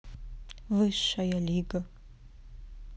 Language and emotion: Russian, neutral